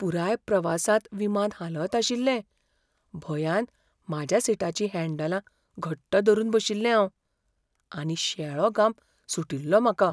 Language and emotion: Goan Konkani, fearful